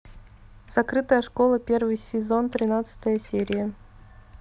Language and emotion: Russian, neutral